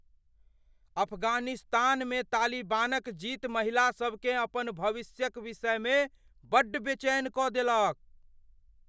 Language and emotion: Maithili, fearful